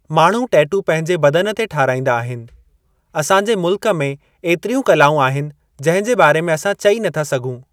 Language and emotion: Sindhi, neutral